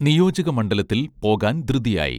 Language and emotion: Malayalam, neutral